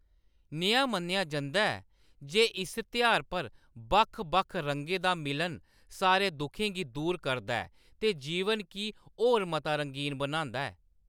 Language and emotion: Dogri, neutral